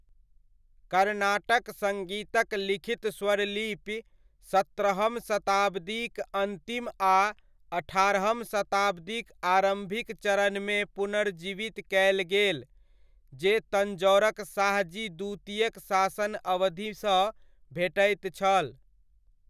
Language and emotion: Maithili, neutral